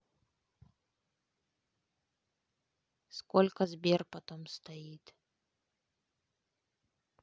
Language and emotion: Russian, neutral